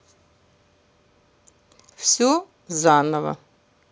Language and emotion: Russian, neutral